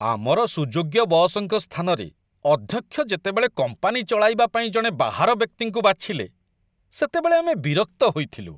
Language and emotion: Odia, disgusted